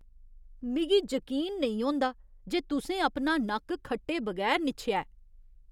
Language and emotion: Dogri, disgusted